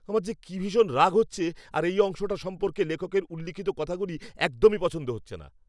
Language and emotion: Bengali, angry